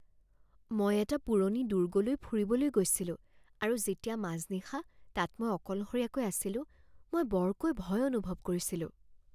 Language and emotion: Assamese, fearful